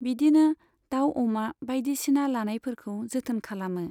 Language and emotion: Bodo, neutral